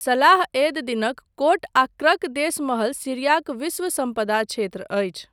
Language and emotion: Maithili, neutral